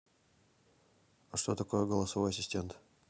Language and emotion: Russian, neutral